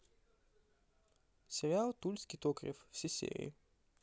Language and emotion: Russian, neutral